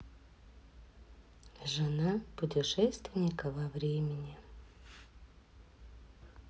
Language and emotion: Russian, sad